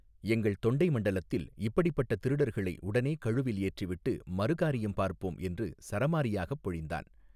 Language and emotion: Tamil, neutral